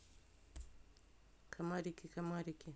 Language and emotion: Russian, neutral